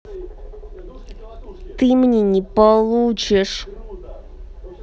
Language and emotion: Russian, angry